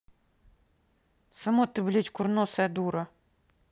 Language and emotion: Russian, angry